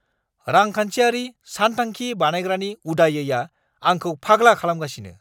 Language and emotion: Bodo, angry